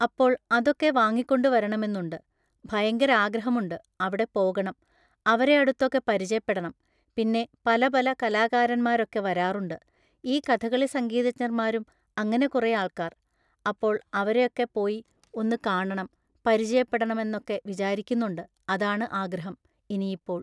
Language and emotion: Malayalam, neutral